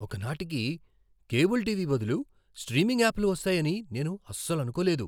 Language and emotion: Telugu, surprised